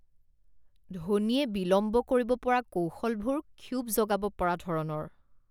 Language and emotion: Assamese, disgusted